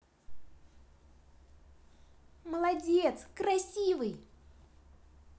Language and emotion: Russian, positive